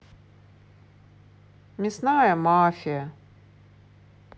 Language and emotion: Russian, neutral